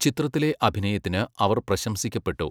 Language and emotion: Malayalam, neutral